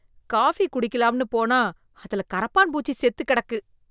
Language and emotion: Tamil, disgusted